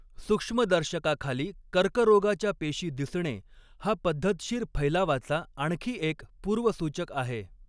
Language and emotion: Marathi, neutral